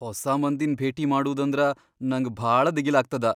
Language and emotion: Kannada, fearful